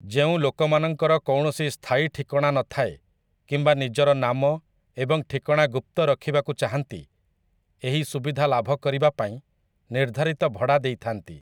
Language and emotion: Odia, neutral